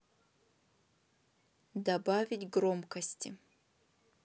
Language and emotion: Russian, neutral